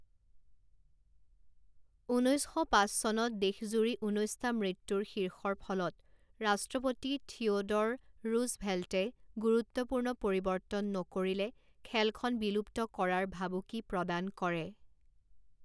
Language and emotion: Assamese, neutral